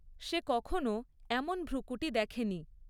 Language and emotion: Bengali, neutral